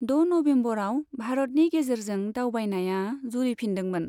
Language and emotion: Bodo, neutral